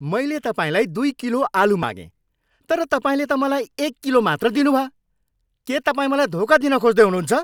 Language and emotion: Nepali, angry